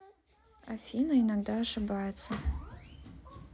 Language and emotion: Russian, neutral